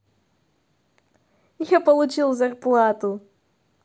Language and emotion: Russian, positive